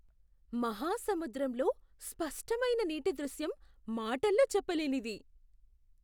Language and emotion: Telugu, surprised